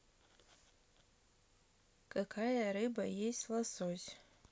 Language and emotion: Russian, neutral